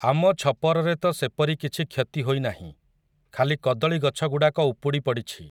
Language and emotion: Odia, neutral